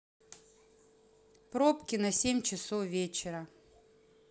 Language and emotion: Russian, neutral